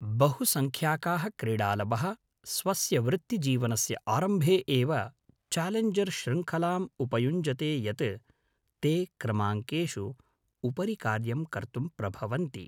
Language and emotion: Sanskrit, neutral